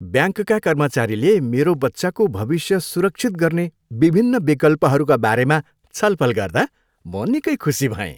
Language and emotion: Nepali, happy